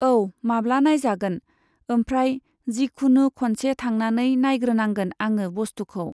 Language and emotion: Bodo, neutral